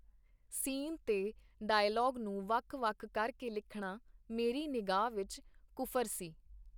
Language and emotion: Punjabi, neutral